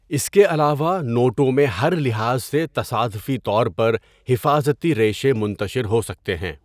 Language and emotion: Urdu, neutral